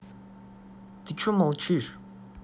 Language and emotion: Russian, angry